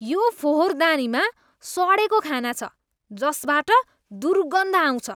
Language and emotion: Nepali, disgusted